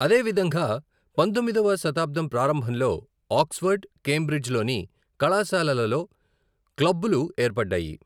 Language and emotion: Telugu, neutral